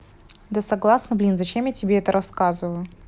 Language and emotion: Russian, neutral